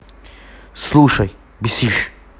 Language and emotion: Russian, angry